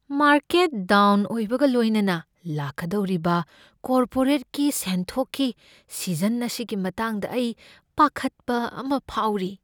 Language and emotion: Manipuri, fearful